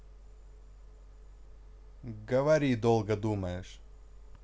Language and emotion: Russian, neutral